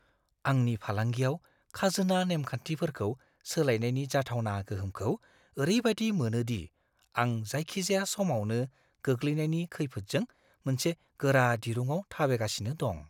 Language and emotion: Bodo, fearful